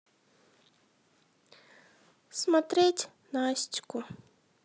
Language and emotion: Russian, sad